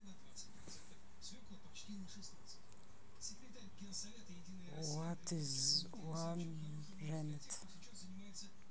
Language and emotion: Russian, neutral